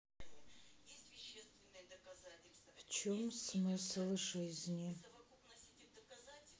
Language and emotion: Russian, sad